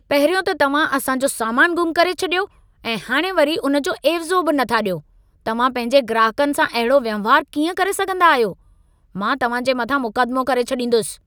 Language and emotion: Sindhi, angry